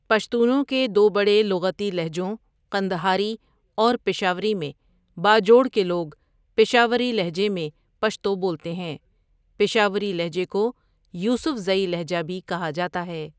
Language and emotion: Urdu, neutral